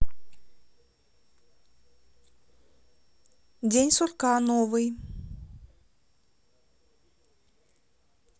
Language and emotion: Russian, neutral